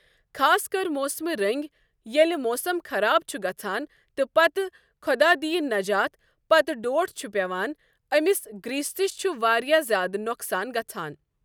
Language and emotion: Kashmiri, neutral